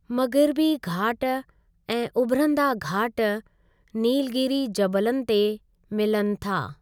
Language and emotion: Sindhi, neutral